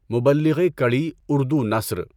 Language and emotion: Urdu, neutral